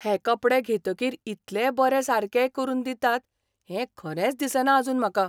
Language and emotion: Goan Konkani, surprised